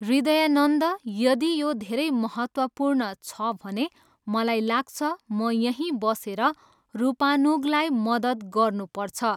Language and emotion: Nepali, neutral